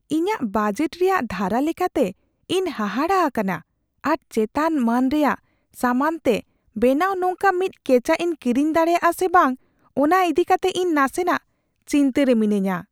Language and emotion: Santali, fearful